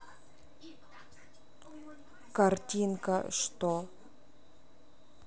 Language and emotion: Russian, neutral